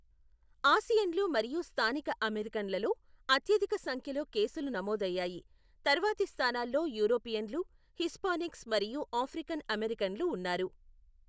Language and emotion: Telugu, neutral